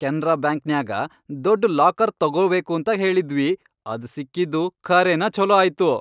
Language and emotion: Kannada, happy